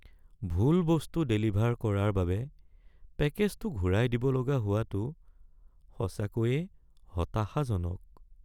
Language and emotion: Assamese, sad